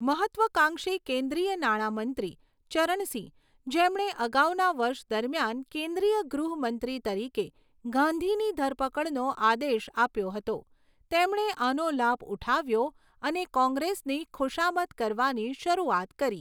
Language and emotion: Gujarati, neutral